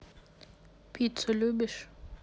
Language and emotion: Russian, neutral